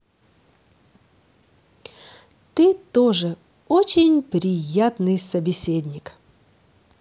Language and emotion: Russian, positive